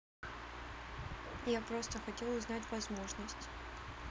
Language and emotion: Russian, neutral